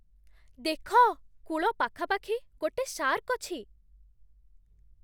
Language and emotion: Odia, surprised